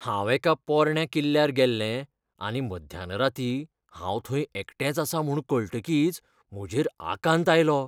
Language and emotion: Goan Konkani, fearful